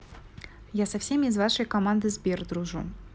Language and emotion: Russian, neutral